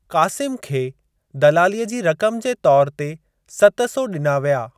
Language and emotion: Sindhi, neutral